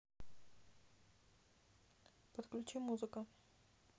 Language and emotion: Russian, neutral